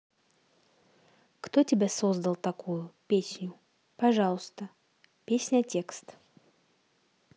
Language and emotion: Russian, neutral